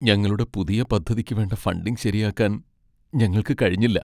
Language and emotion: Malayalam, sad